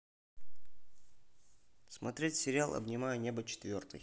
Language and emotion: Russian, neutral